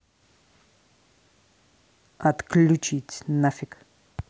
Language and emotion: Russian, angry